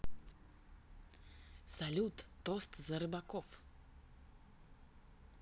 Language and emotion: Russian, positive